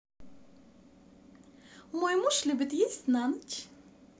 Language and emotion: Russian, positive